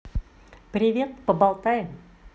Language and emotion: Russian, positive